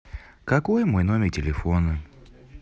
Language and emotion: Russian, neutral